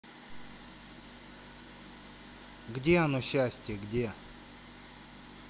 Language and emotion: Russian, neutral